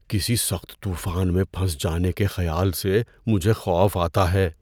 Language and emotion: Urdu, fearful